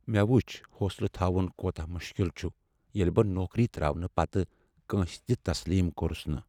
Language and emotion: Kashmiri, sad